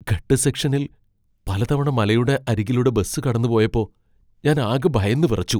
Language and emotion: Malayalam, fearful